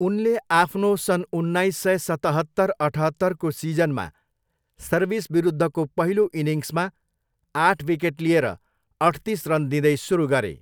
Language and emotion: Nepali, neutral